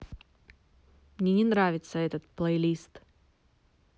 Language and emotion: Russian, angry